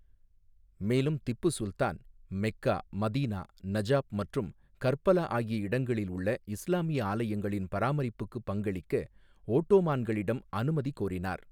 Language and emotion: Tamil, neutral